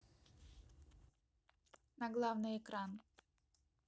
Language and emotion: Russian, neutral